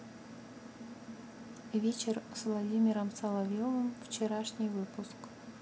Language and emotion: Russian, neutral